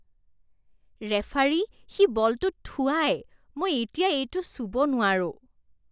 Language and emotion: Assamese, disgusted